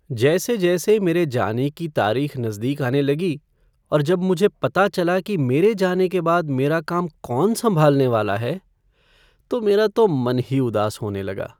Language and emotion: Hindi, sad